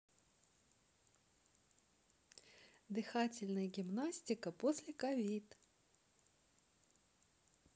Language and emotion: Russian, neutral